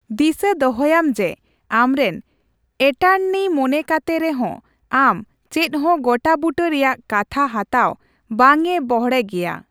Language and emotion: Santali, neutral